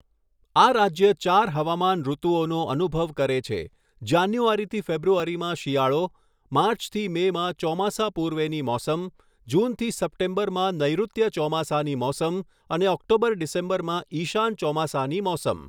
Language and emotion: Gujarati, neutral